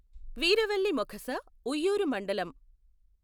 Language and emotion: Telugu, neutral